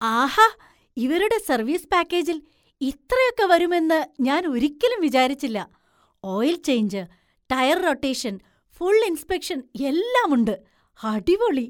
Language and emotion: Malayalam, surprised